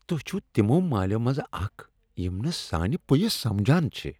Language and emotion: Kashmiri, disgusted